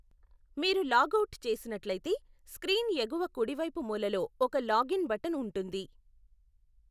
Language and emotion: Telugu, neutral